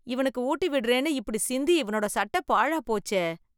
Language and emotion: Tamil, disgusted